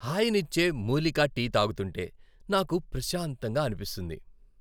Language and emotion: Telugu, happy